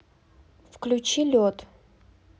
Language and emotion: Russian, neutral